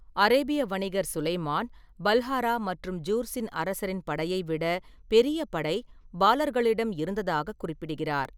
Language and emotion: Tamil, neutral